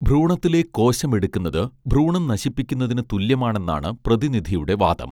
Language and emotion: Malayalam, neutral